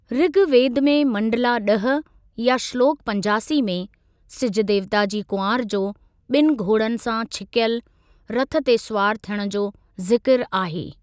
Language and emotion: Sindhi, neutral